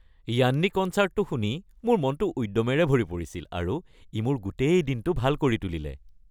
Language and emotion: Assamese, happy